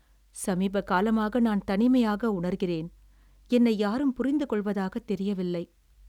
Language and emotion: Tamil, sad